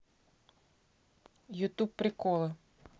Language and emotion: Russian, neutral